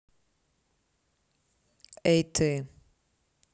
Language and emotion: Russian, neutral